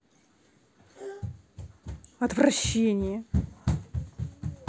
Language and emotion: Russian, angry